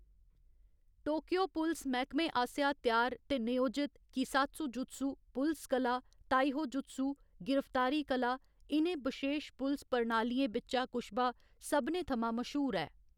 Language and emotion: Dogri, neutral